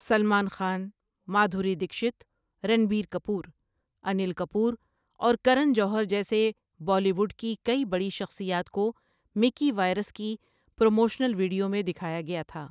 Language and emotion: Urdu, neutral